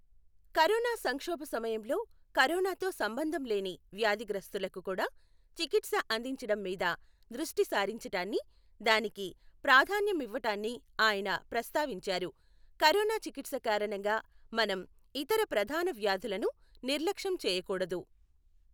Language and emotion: Telugu, neutral